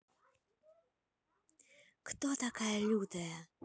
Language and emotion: Russian, neutral